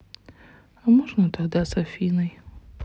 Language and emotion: Russian, sad